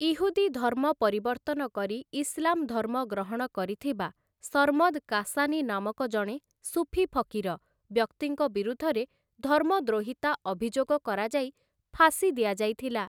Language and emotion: Odia, neutral